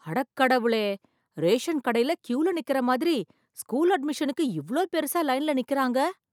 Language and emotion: Tamil, surprised